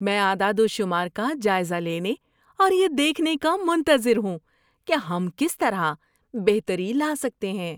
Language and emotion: Urdu, happy